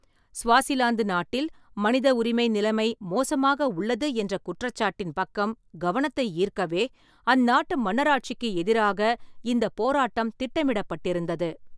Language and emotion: Tamil, neutral